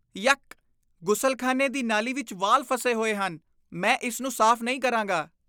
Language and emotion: Punjabi, disgusted